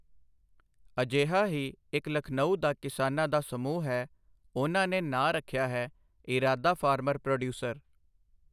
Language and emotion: Punjabi, neutral